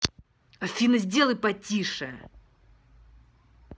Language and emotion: Russian, angry